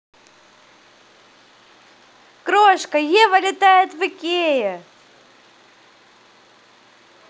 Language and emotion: Russian, positive